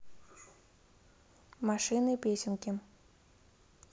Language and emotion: Russian, neutral